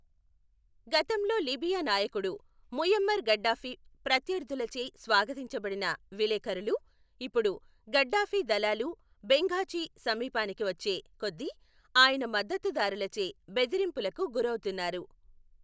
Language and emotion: Telugu, neutral